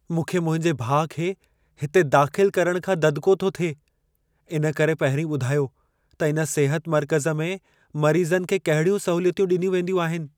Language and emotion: Sindhi, fearful